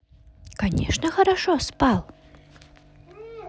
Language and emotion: Russian, positive